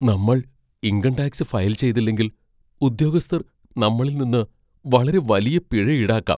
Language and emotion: Malayalam, fearful